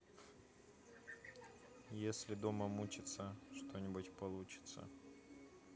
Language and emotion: Russian, neutral